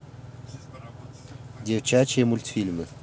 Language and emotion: Russian, neutral